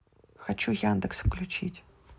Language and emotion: Russian, neutral